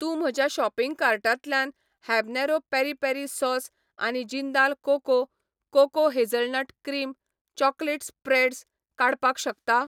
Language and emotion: Goan Konkani, neutral